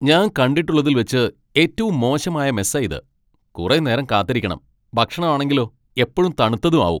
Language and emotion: Malayalam, angry